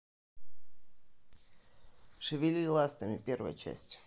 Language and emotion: Russian, neutral